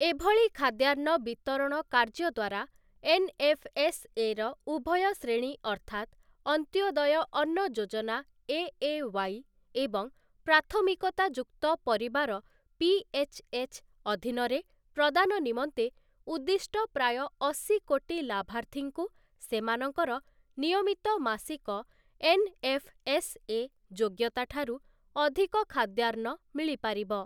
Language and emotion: Odia, neutral